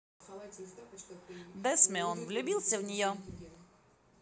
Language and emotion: Russian, positive